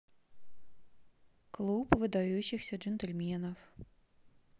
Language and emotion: Russian, neutral